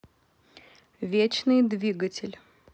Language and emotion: Russian, neutral